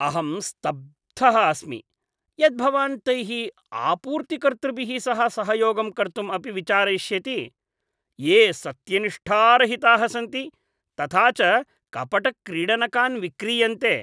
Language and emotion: Sanskrit, disgusted